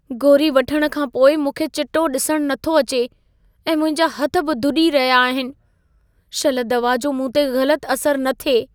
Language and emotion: Sindhi, fearful